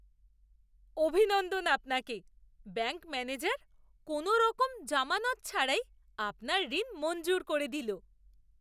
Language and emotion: Bengali, surprised